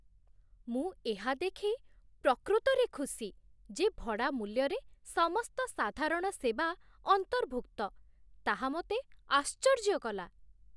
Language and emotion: Odia, surprised